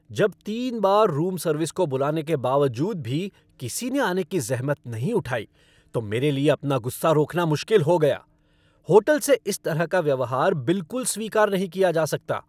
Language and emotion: Hindi, angry